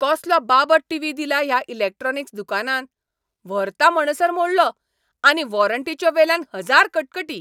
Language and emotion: Goan Konkani, angry